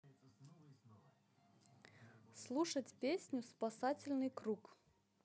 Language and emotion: Russian, neutral